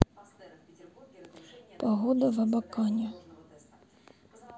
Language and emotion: Russian, sad